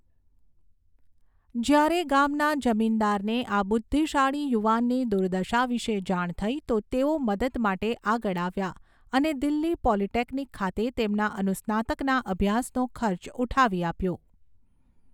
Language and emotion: Gujarati, neutral